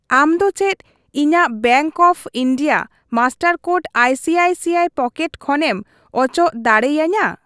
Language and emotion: Santali, neutral